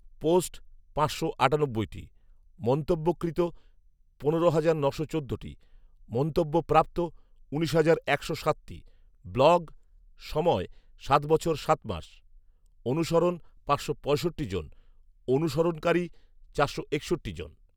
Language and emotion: Bengali, neutral